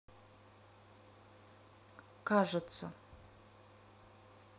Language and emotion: Russian, neutral